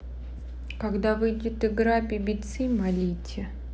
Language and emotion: Russian, neutral